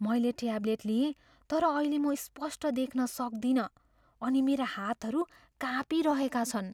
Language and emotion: Nepali, fearful